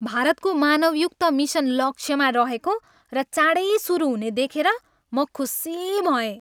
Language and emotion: Nepali, happy